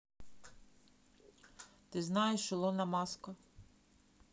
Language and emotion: Russian, neutral